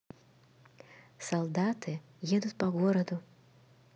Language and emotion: Russian, neutral